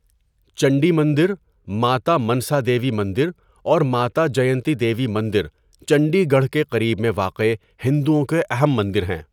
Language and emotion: Urdu, neutral